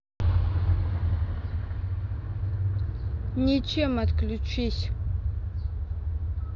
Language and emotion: Russian, neutral